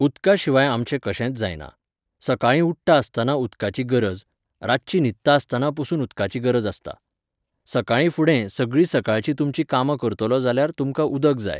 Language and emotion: Goan Konkani, neutral